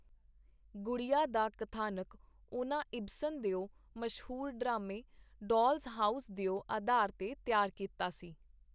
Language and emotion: Punjabi, neutral